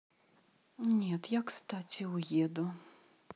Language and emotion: Russian, sad